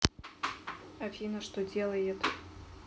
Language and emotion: Russian, neutral